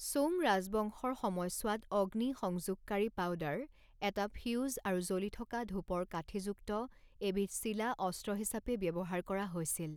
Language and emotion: Assamese, neutral